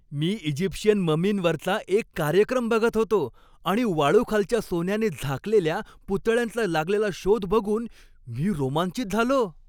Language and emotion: Marathi, happy